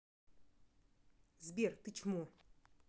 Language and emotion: Russian, angry